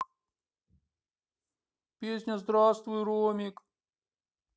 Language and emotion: Russian, sad